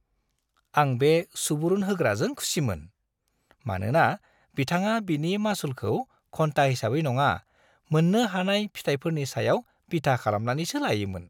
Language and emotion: Bodo, happy